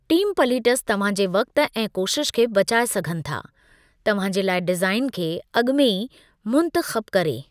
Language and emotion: Sindhi, neutral